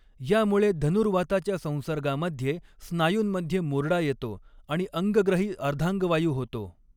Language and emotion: Marathi, neutral